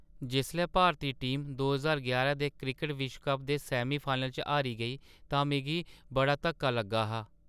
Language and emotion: Dogri, sad